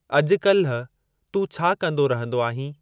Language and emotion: Sindhi, neutral